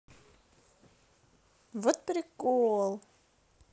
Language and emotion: Russian, positive